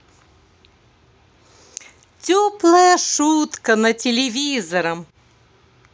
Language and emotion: Russian, positive